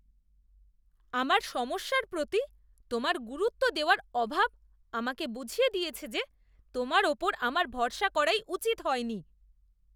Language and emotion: Bengali, disgusted